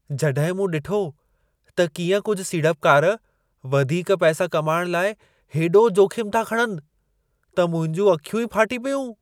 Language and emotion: Sindhi, surprised